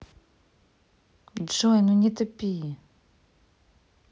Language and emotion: Russian, angry